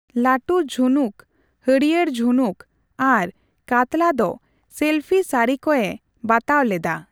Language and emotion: Santali, neutral